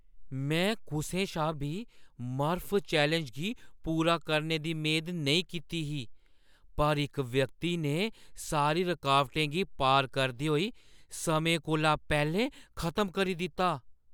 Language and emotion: Dogri, surprised